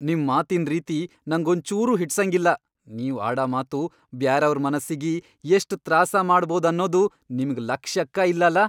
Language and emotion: Kannada, angry